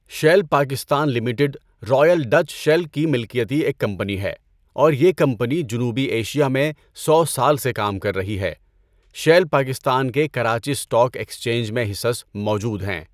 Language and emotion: Urdu, neutral